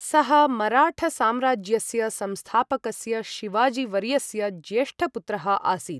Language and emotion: Sanskrit, neutral